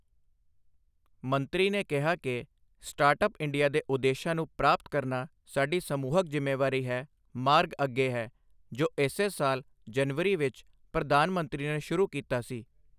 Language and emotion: Punjabi, neutral